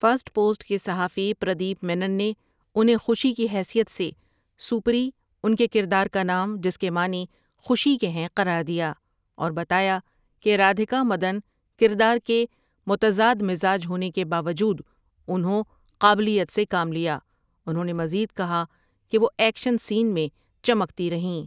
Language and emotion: Urdu, neutral